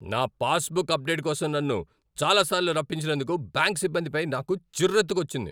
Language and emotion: Telugu, angry